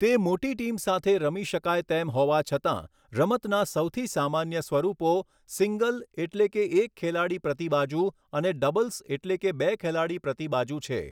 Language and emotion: Gujarati, neutral